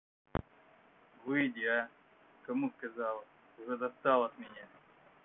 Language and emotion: Russian, angry